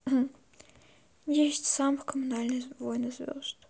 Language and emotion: Russian, sad